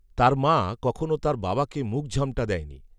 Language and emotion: Bengali, neutral